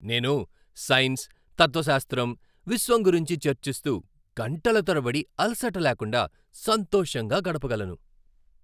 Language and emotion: Telugu, happy